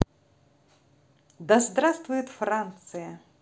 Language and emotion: Russian, positive